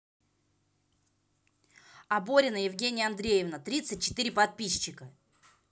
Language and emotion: Russian, positive